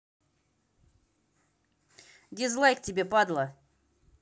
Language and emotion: Russian, angry